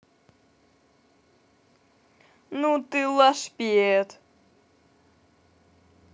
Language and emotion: Russian, positive